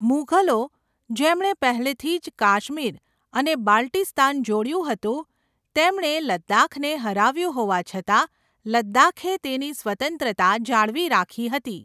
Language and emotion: Gujarati, neutral